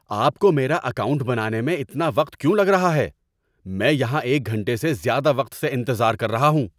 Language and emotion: Urdu, angry